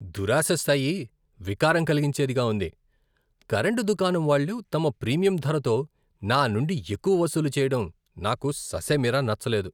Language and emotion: Telugu, disgusted